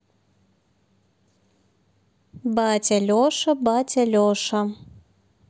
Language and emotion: Russian, neutral